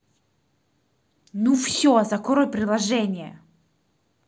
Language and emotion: Russian, angry